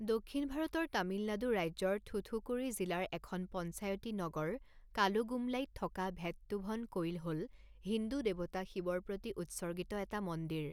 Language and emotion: Assamese, neutral